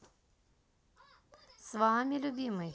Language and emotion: Russian, positive